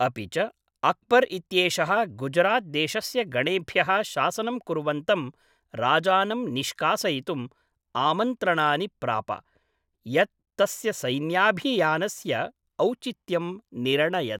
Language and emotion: Sanskrit, neutral